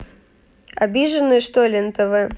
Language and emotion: Russian, neutral